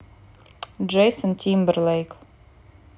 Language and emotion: Russian, neutral